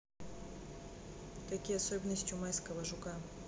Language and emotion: Russian, neutral